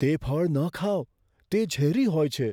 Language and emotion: Gujarati, fearful